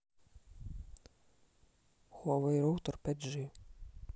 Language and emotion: Russian, neutral